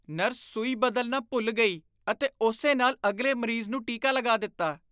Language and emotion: Punjabi, disgusted